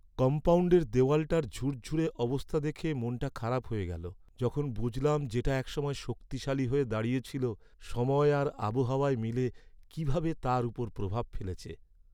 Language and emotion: Bengali, sad